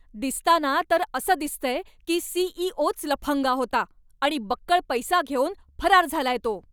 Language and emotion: Marathi, angry